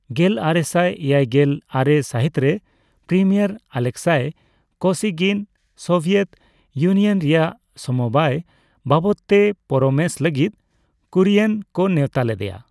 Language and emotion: Santali, neutral